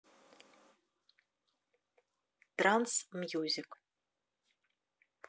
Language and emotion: Russian, neutral